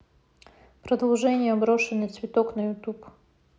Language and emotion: Russian, neutral